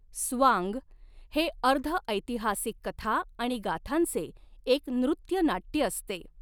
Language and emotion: Marathi, neutral